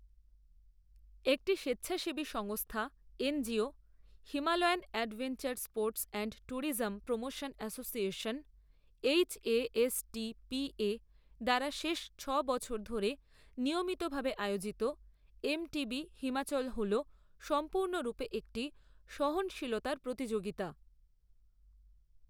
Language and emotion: Bengali, neutral